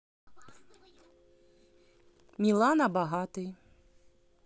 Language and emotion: Russian, neutral